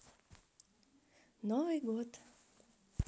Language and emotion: Russian, positive